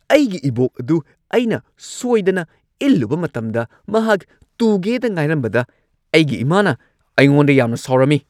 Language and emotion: Manipuri, angry